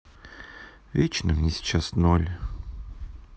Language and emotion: Russian, sad